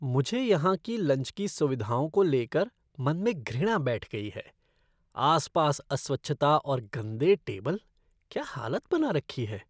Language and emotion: Hindi, disgusted